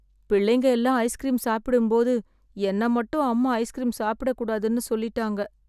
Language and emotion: Tamil, sad